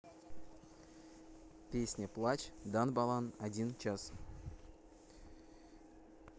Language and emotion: Russian, neutral